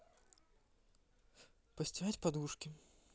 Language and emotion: Russian, neutral